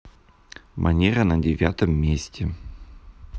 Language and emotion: Russian, neutral